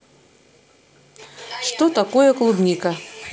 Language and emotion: Russian, neutral